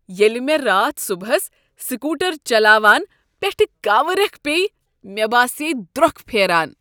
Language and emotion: Kashmiri, disgusted